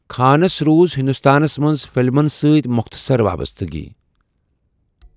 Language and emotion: Kashmiri, neutral